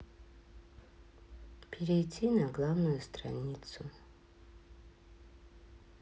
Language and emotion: Russian, sad